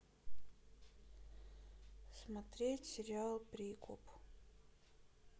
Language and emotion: Russian, sad